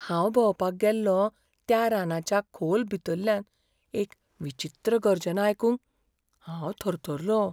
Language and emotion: Goan Konkani, fearful